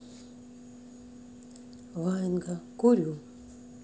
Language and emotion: Russian, neutral